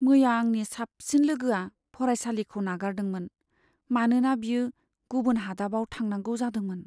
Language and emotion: Bodo, sad